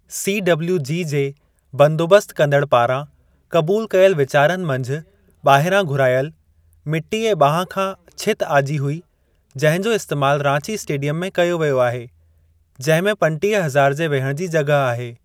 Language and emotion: Sindhi, neutral